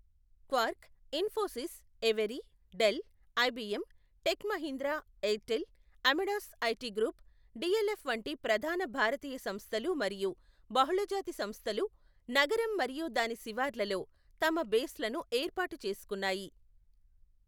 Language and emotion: Telugu, neutral